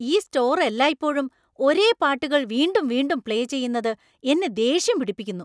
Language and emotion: Malayalam, angry